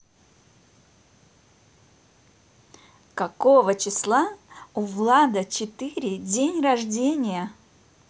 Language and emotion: Russian, positive